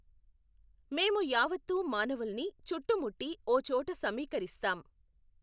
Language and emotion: Telugu, neutral